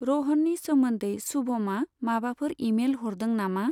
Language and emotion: Bodo, neutral